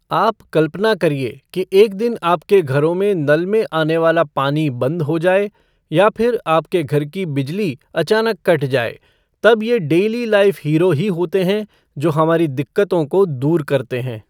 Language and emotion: Hindi, neutral